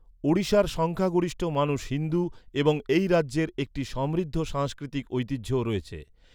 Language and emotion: Bengali, neutral